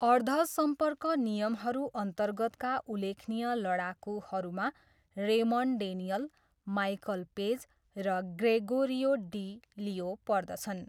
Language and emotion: Nepali, neutral